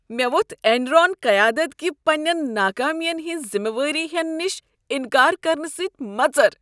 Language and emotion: Kashmiri, disgusted